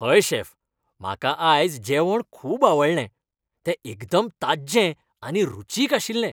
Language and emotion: Goan Konkani, happy